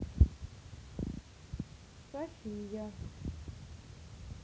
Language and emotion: Russian, neutral